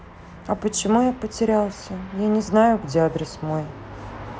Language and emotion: Russian, sad